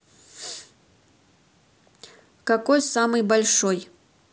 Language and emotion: Russian, neutral